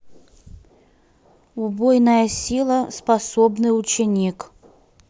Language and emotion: Russian, neutral